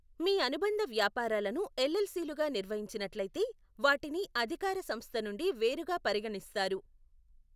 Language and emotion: Telugu, neutral